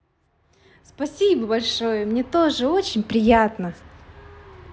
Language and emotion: Russian, positive